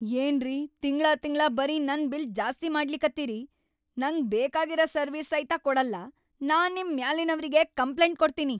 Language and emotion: Kannada, angry